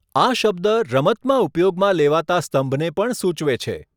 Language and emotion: Gujarati, neutral